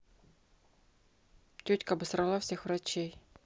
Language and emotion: Russian, angry